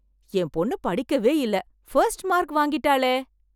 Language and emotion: Tamil, surprised